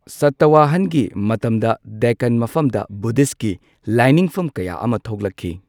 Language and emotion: Manipuri, neutral